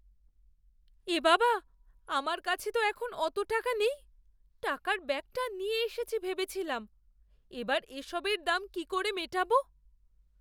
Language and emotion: Bengali, fearful